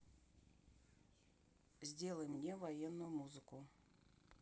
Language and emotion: Russian, neutral